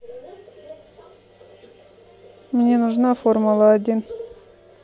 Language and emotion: Russian, neutral